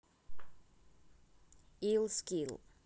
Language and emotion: Russian, neutral